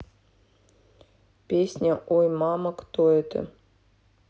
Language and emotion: Russian, neutral